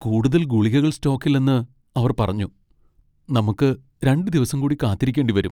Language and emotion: Malayalam, sad